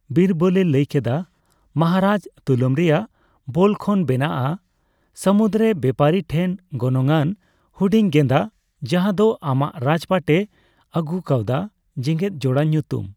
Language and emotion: Santali, neutral